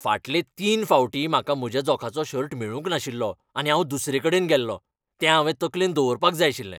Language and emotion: Goan Konkani, angry